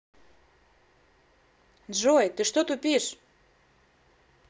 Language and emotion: Russian, angry